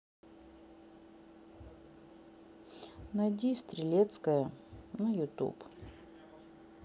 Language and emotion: Russian, sad